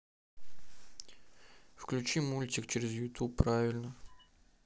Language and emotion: Russian, neutral